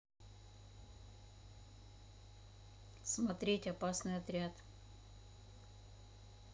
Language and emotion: Russian, neutral